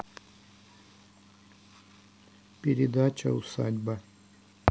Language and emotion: Russian, neutral